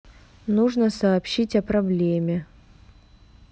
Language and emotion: Russian, neutral